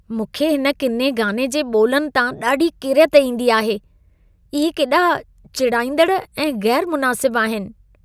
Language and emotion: Sindhi, disgusted